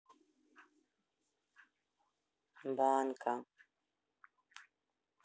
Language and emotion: Russian, neutral